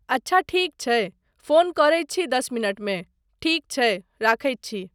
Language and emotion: Maithili, neutral